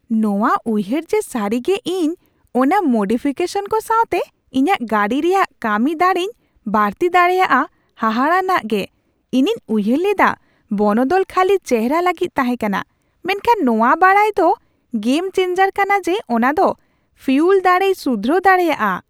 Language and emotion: Santali, surprised